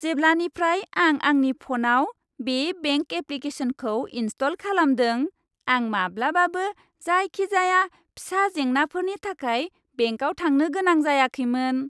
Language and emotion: Bodo, happy